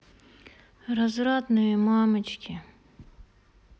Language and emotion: Russian, sad